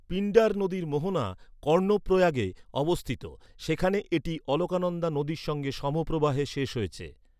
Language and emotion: Bengali, neutral